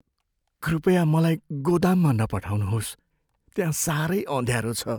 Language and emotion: Nepali, fearful